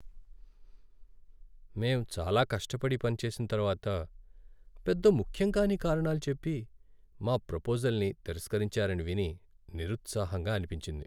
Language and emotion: Telugu, sad